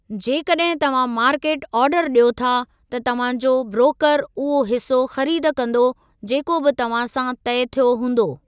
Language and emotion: Sindhi, neutral